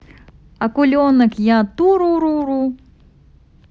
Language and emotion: Russian, positive